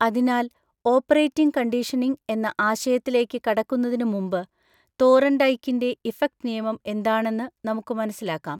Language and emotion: Malayalam, neutral